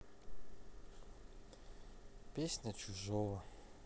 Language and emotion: Russian, sad